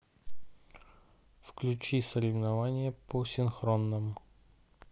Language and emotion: Russian, neutral